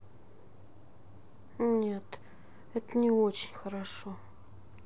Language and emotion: Russian, sad